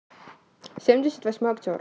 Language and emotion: Russian, neutral